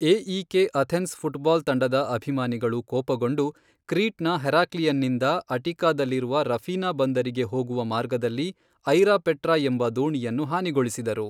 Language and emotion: Kannada, neutral